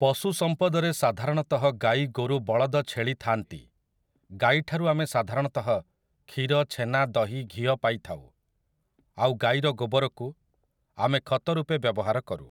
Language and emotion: Odia, neutral